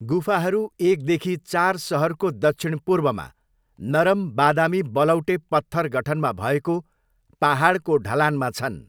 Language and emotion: Nepali, neutral